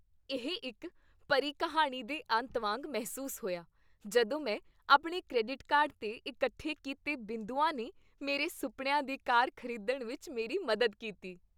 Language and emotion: Punjabi, happy